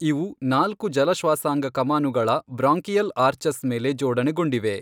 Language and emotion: Kannada, neutral